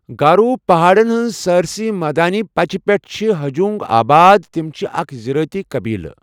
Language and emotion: Kashmiri, neutral